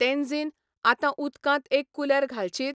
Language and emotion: Goan Konkani, neutral